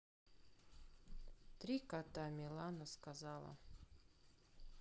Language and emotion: Russian, sad